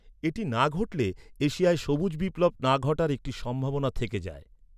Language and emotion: Bengali, neutral